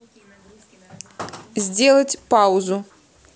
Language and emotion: Russian, neutral